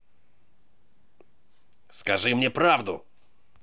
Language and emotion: Russian, angry